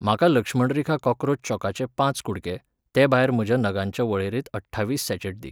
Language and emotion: Goan Konkani, neutral